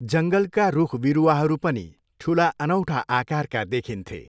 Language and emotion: Nepali, neutral